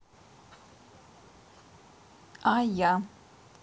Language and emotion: Russian, neutral